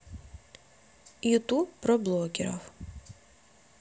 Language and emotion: Russian, neutral